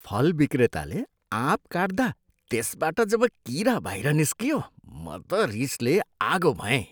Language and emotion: Nepali, disgusted